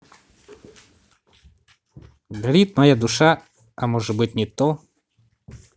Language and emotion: Russian, neutral